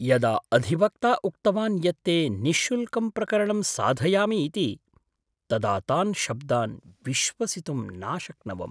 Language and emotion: Sanskrit, surprised